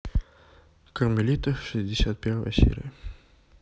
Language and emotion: Russian, neutral